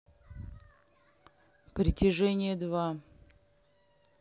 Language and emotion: Russian, neutral